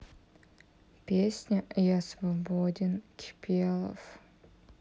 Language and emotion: Russian, sad